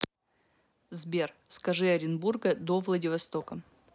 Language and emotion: Russian, neutral